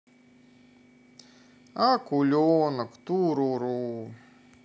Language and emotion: Russian, sad